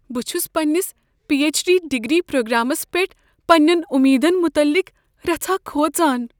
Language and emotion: Kashmiri, fearful